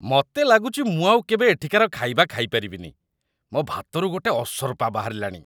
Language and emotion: Odia, disgusted